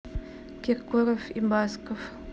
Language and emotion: Russian, neutral